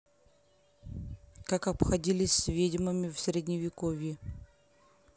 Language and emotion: Russian, neutral